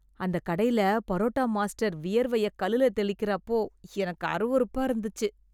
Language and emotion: Tamil, disgusted